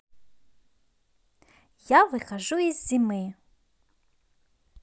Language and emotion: Russian, positive